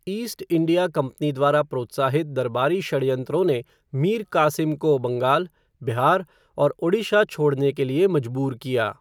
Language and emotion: Hindi, neutral